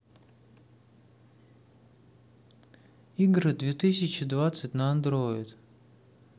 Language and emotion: Russian, neutral